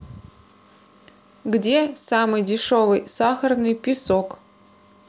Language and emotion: Russian, neutral